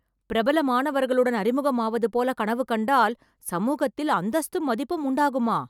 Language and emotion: Tamil, surprised